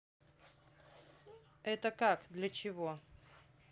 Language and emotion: Russian, neutral